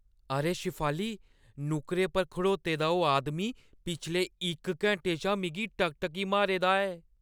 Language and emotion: Dogri, fearful